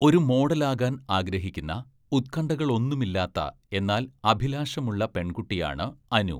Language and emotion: Malayalam, neutral